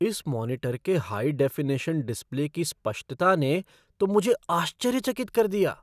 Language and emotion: Hindi, surprised